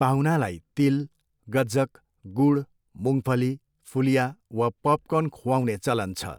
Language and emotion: Nepali, neutral